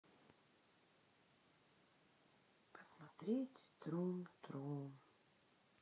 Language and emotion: Russian, sad